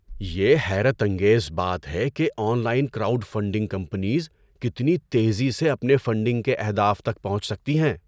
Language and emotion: Urdu, surprised